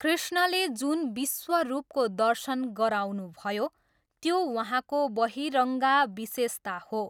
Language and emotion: Nepali, neutral